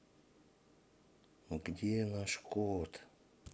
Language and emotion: Russian, neutral